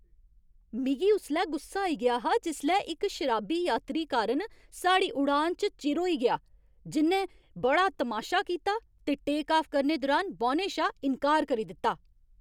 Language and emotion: Dogri, angry